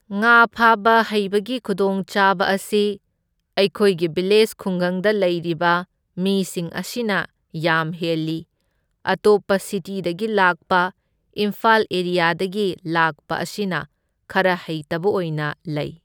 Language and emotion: Manipuri, neutral